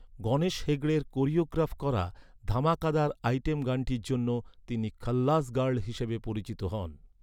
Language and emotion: Bengali, neutral